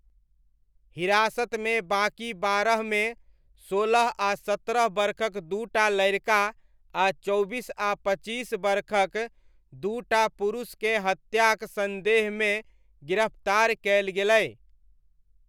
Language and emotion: Maithili, neutral